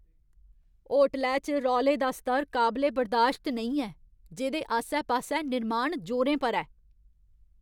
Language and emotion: Dogri, angry